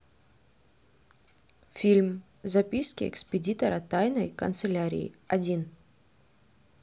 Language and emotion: Russian, neutral